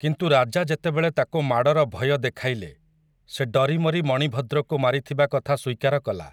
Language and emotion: Odia, neutral